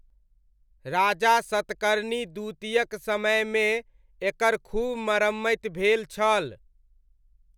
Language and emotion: Maithili, neutral